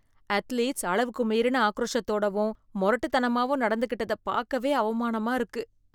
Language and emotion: Tamil, disgusted